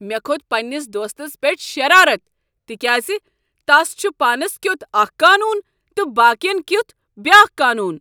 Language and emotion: Kashmiri, angry